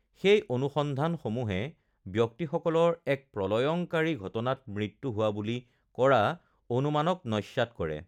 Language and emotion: Assamese, neutral